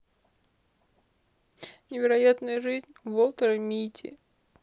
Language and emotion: Russian, sad